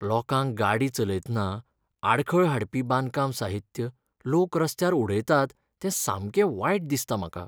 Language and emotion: Goan Konkani, sad